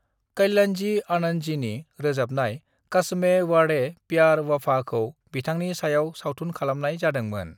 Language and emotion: Bodo, neutral